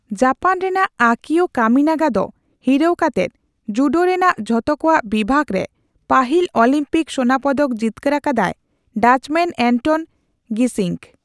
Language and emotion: Santali, neutral